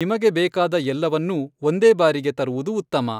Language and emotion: Kannada, neutral